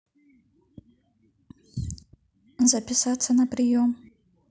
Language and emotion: Russian, neutral